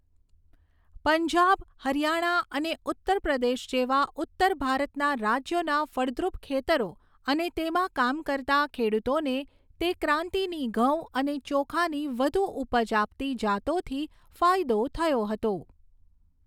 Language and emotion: Gujarati, neutral